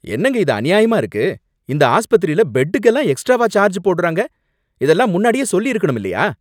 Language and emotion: Tamil, angry